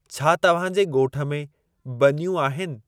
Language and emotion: Sindhi, neutral